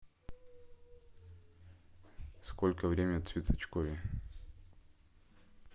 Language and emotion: Russian, neutral